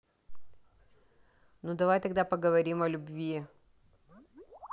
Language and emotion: Russian, neutral